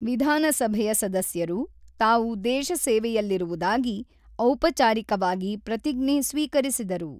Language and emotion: Kannada, neutral